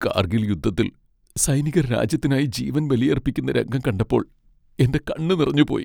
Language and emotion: Malayalam, sad